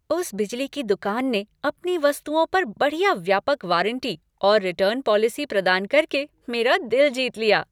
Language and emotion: Hindi, happy